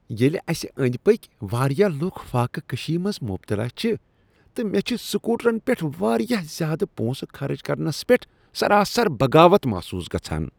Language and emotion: Kashmiri, disgusted